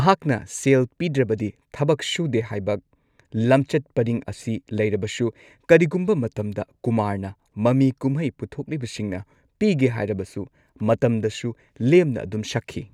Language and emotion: Manipuri, neutral